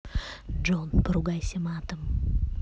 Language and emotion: Russian, neutral